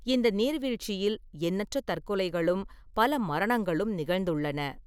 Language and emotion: Tamil, neutral